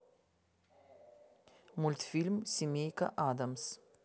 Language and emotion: Russian, neutral